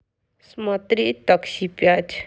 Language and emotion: Russian, sad